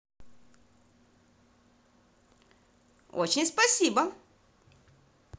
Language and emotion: Russian, positive